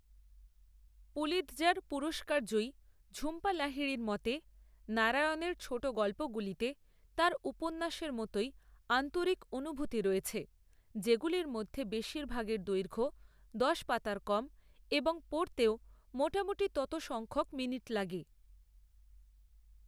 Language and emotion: Bengali, neutral